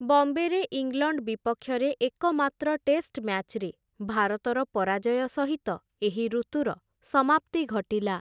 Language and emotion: Odia, neutral